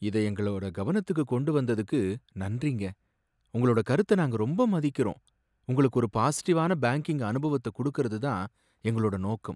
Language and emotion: Tamil, sad